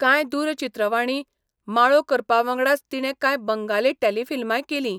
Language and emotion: Goan Konkani, neutral